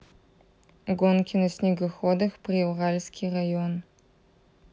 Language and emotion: Russian, neutral